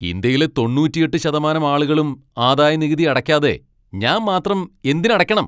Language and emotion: Malayalam, angry